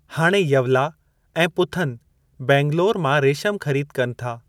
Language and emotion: Sindhi, neutral